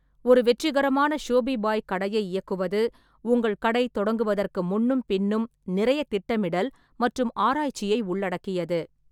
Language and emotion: Tamil, neutral